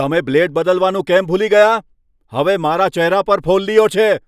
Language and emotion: Gujarati, angry